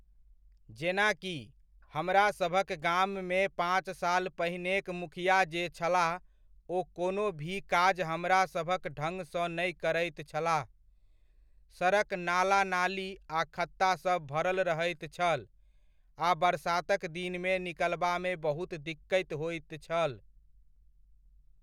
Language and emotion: Maithili, neutral